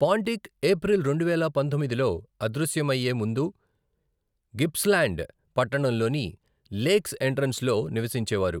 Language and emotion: Telugu, neutral